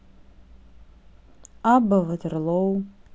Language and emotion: Russian, neutral